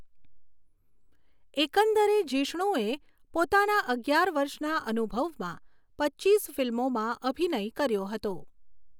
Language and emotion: Gujarati, neutral